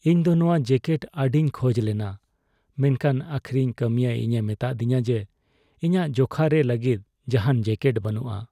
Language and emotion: Santali, sad